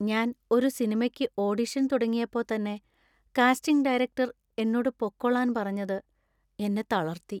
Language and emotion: Malayalam, sad